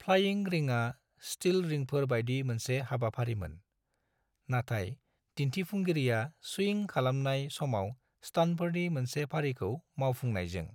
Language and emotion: Bodo, neutral